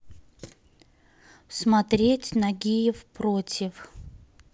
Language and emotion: Russian, neutral